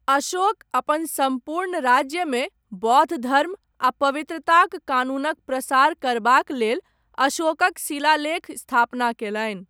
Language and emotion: Maithili, neutral